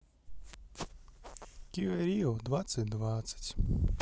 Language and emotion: Russian, neutral